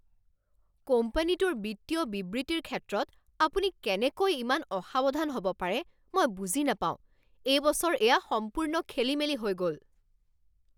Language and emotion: Assamese, angry